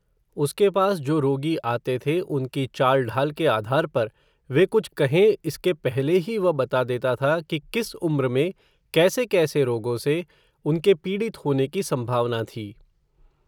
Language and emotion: Hindi, neutral